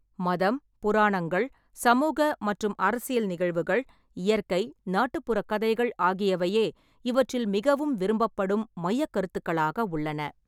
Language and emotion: Tamil, neutral